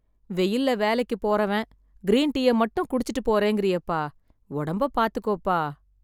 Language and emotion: Tamil, sad